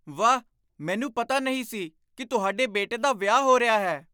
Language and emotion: Punjabi, surprised